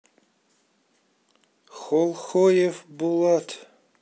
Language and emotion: Russian, neutral